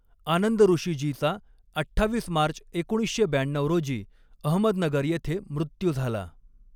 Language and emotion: Marathi, neutral